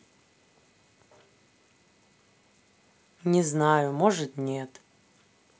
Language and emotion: Russian, neutral